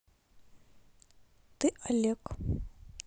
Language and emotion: Russian, neutral